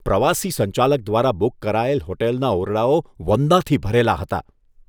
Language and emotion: Gujarati, disgusted